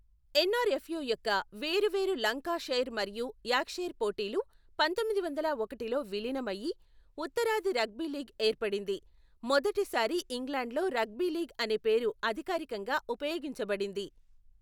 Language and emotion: Telugu, neutral